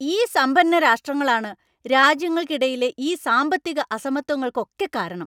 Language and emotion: Malayalam, angry